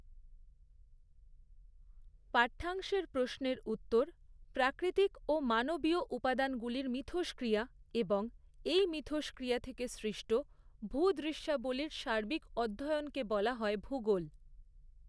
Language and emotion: Bengali, neutral